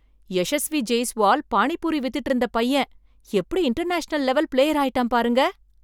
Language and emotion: Tamil, surprised